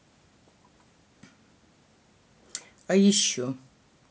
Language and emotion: Russian, neutral